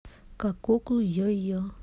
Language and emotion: Russian, neutral